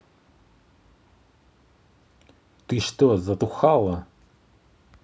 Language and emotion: Russian, angry